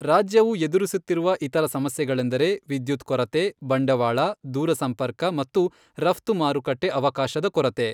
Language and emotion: Kannada, neutral